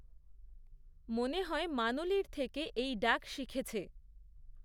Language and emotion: Bengali, neutral